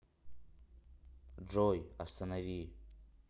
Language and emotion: Russian, neutral